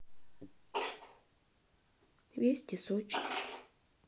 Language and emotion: Russian, sad